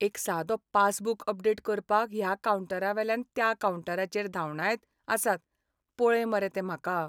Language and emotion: Goan Konkani, sad